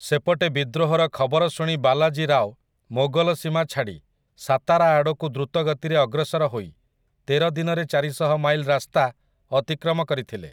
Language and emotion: Odia, neutral